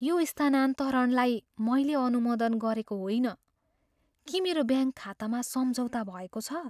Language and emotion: Nepali, fearful